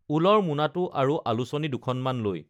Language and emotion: Assamese, neutral